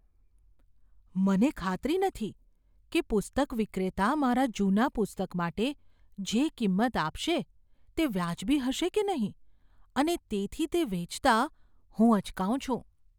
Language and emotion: Gujarati, fearful